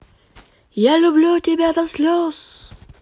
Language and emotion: Russian, positive